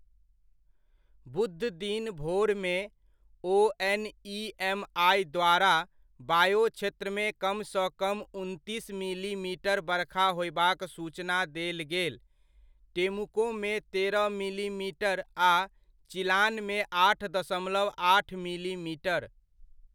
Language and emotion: Maithili, neutral